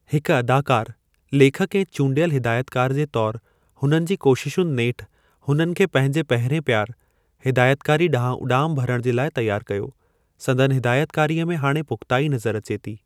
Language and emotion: Sindhi, neutral